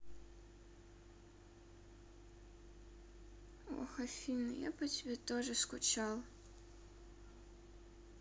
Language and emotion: Russian, sad